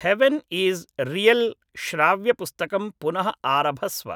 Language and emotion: Sanskrit, neutral